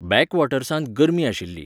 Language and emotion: Goan Konkani, neutral